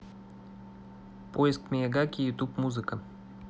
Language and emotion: Russian, neutral